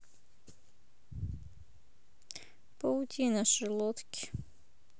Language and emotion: Russian, sad